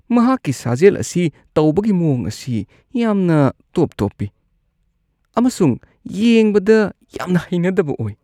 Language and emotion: Manipuri, disgusted